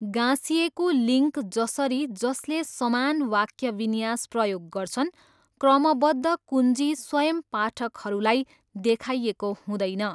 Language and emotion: Nepali, neutral